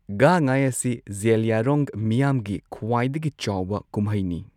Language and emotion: Manipuri, neutral